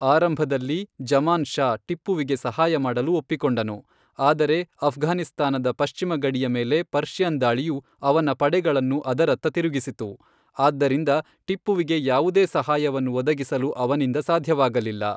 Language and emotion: Kannada, neutral